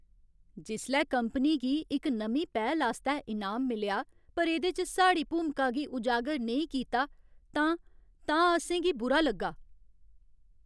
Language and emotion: Dogri, sad